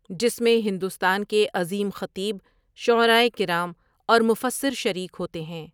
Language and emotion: Urdu, neutral